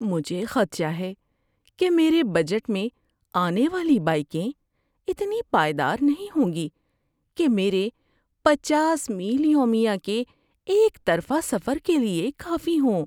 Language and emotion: Urdu, fearful